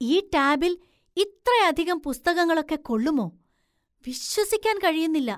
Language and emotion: Malayalam, surprised